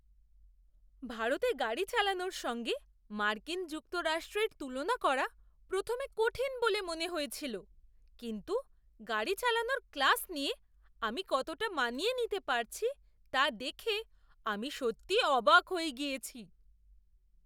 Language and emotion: Bengali, surprised